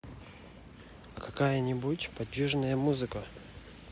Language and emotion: Russian, neutral